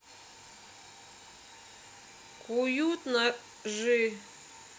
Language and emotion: Russian, neutral